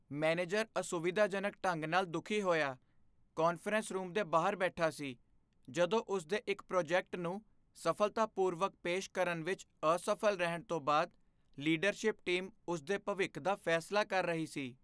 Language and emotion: Punjabi, fearful